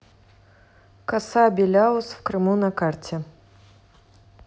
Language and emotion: Russian, neutral